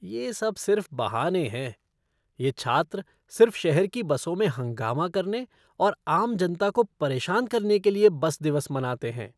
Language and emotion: Hindi, disgusted